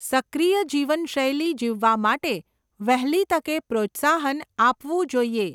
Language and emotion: Gujarati, neutral